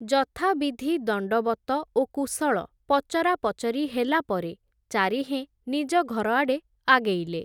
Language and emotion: Odia, neutral